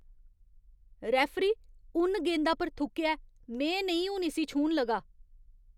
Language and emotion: Dogri, disgusted